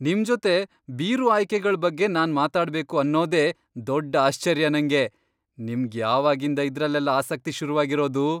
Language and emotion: Kannada, surprised